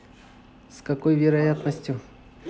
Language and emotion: Russian, neutral